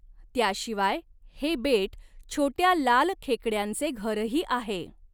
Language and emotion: Marathi, neutral